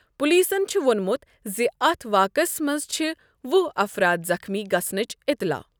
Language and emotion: Kashmiri, neutral